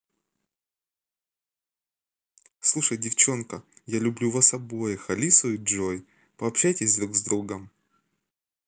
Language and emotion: Russian, positive